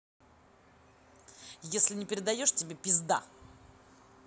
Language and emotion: Russian, angry